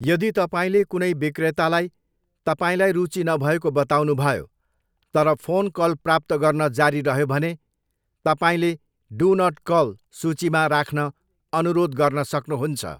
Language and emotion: Nepali, neutral